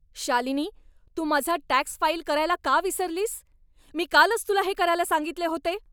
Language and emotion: Marathi, angry